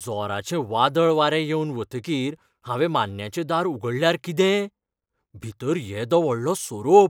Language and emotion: Goan Konkani, fearful